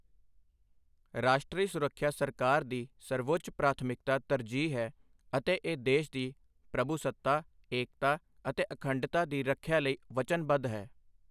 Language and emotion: Punjabi, neutral